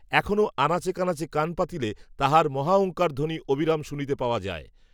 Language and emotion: Bengali, neutral